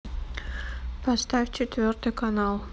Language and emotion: Russian, neutral